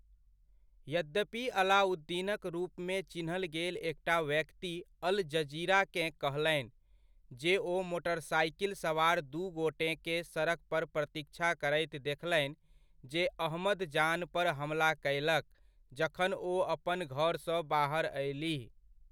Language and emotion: Maithili, neutral